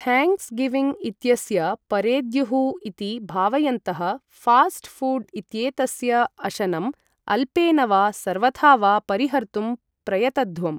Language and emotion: Sanskrit, neutral